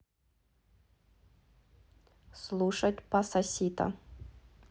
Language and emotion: Russian, neutral